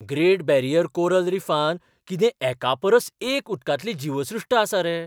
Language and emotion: Goan Konkani, surprised